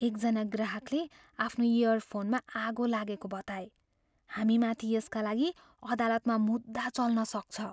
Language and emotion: Nepali, fearful